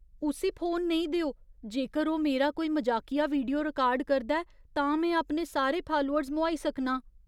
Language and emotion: Dogri, fearful